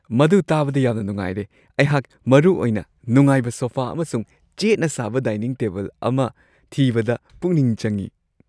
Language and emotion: Manipuri, happy